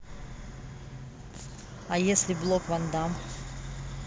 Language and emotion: Russian, neutral